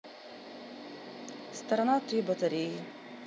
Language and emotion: Russian, neutral